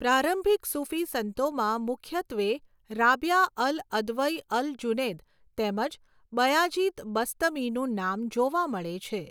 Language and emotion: Gujarati, neutral